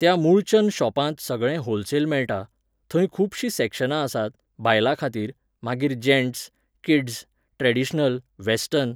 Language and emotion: Goan Konkani, neutral